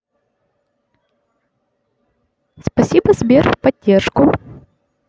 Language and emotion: Russian, neutral